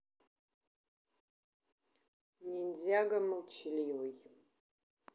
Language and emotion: Russian, neutral